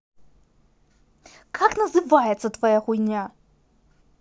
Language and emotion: Russian, angry